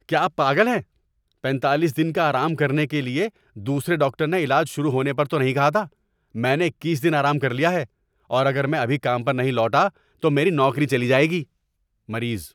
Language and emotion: Urdu, angry